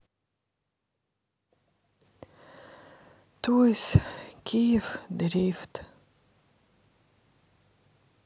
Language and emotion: Russian, sad